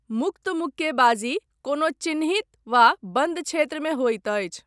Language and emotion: Maithili, neutral